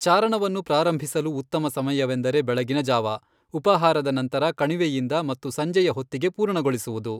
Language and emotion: Kannada, neutral